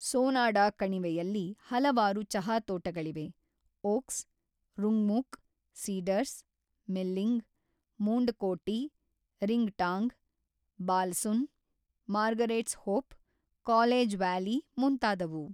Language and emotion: Kannada, neutral